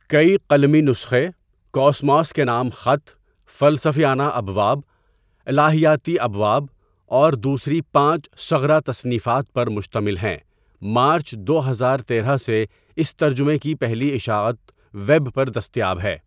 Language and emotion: Urdu, neutral